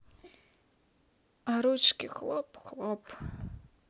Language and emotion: Russian, sad